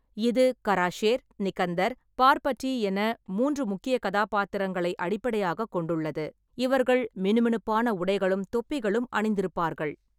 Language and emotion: Tamil, neutral